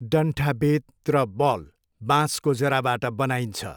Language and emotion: Nepali, neutral